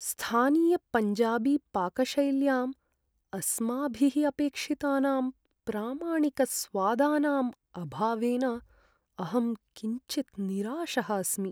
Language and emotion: Sanskrit, sad